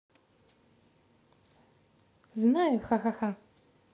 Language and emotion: Russian, positive